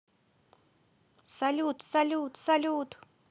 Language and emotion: Russian, positive